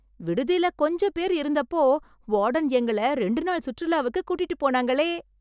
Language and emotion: Tamil, happy